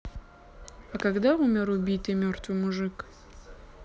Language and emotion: Russian, neutral